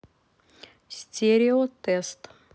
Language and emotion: Russian, neutral